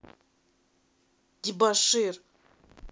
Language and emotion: Russian, angry